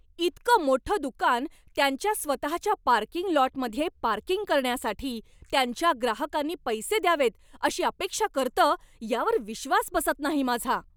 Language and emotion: Marathi, angry